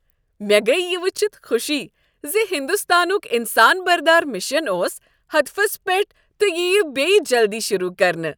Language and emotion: Kashmiri, happy